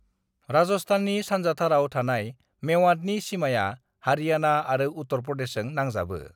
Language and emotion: Bodo, neutral